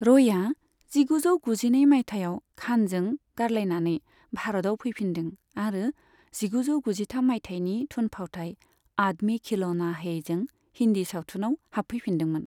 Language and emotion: Bodo, neutral